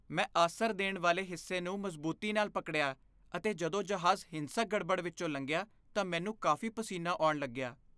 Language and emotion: Punjabi, fearful